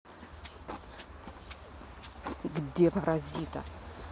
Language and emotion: Russian, angry